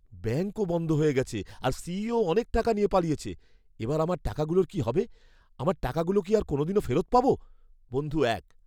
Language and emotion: Bengali, fearful